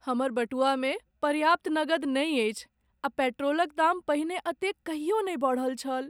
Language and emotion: Maithili, sad